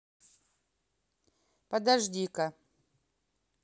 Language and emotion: Russian, neutral